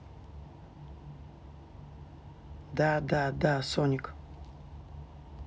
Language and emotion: Russian, neutral